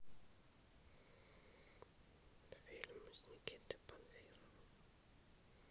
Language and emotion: Russian, neutral